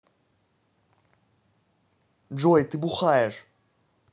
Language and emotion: Russian, angry